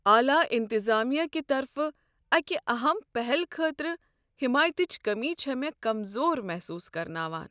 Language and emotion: Kashmiri, sad